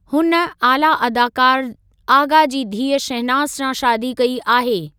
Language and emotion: Sindhi, neutral